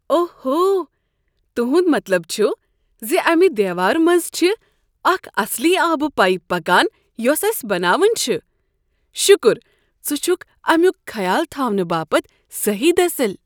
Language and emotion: Kashmiri, surprised